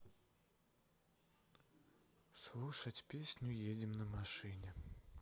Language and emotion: Russian, sad